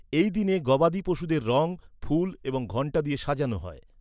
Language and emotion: Bengali, neutral